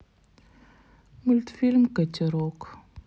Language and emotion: Russian, sad